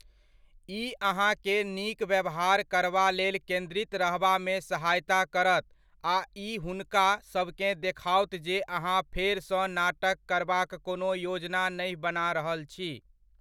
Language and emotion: Maithili, neutral